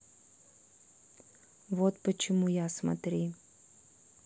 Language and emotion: Russian, neutral